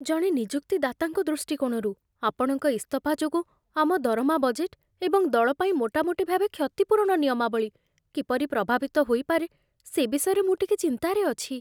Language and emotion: Odia, fearful